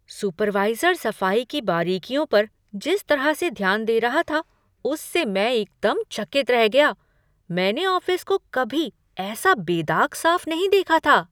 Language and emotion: Hindi, surprised